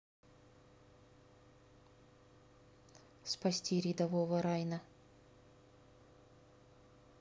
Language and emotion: Russian, neutral